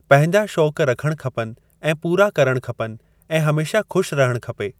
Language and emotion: Sindhi, neutral